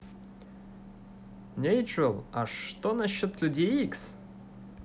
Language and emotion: Russian, positive